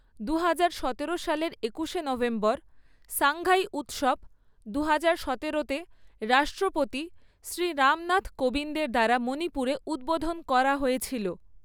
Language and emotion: Bengali, neutral